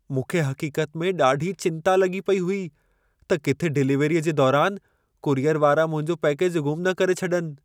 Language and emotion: Sindhi, fearful